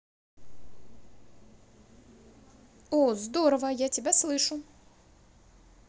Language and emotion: Russian, positive